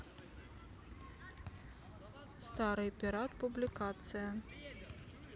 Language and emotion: Russian, neutral